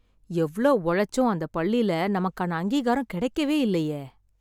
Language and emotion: Tamil, sad